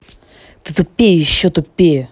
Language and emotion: Russian, angry